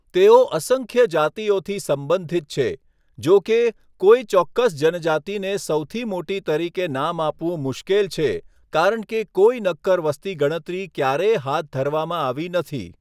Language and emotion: Gujarati, neutral